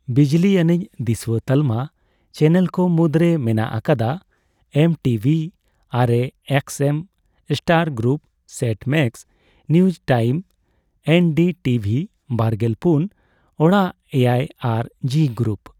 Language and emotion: Santali, neutral